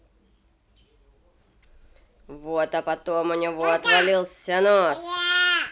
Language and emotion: Russian, angry